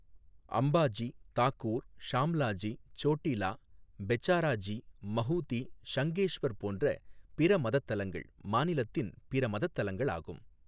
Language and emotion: Tamil, neutral